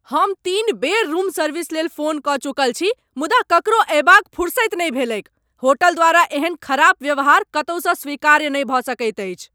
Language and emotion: Maithili, angry